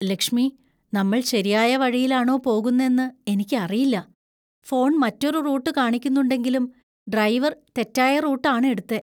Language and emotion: Malayalam, fearful